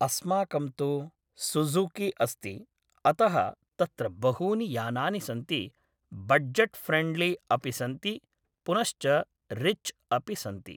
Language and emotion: Sanskrit, neutral